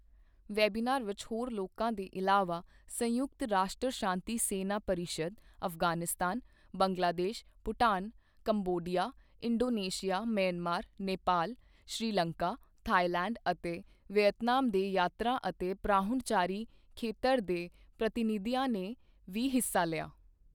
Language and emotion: Punjabi, neutral